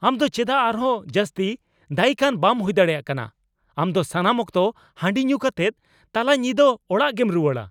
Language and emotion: Santali, angry